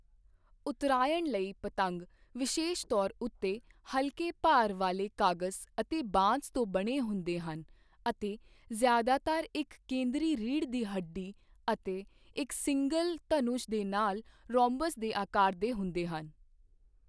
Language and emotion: Punjabi, neutral